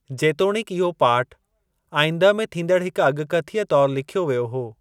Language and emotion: Sindhi, neutral